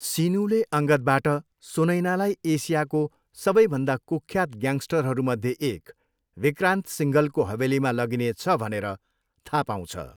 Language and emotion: Nepali, neutral